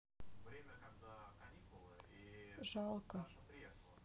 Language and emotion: Russian, sad